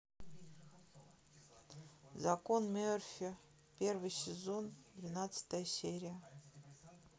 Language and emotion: Russian, sad